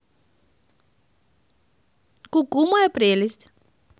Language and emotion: Russian, positive